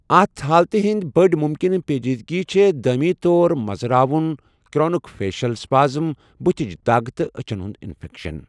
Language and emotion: Kashmiri, neutral